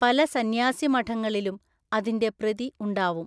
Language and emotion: Malayalam, neutral